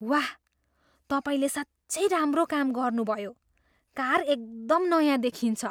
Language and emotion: Nepali, surprised